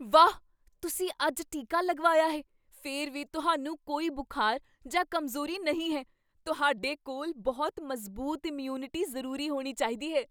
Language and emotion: Punjabi, surprised